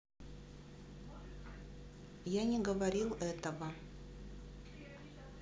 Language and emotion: Russian, neutral